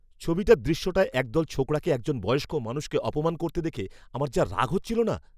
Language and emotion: Bengali, angry